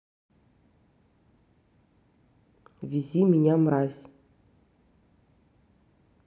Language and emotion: Russian, neutral